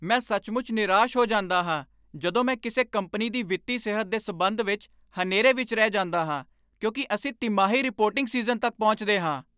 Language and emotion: Punjabi, angry